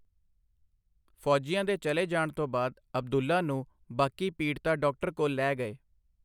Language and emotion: Punjabi, neutral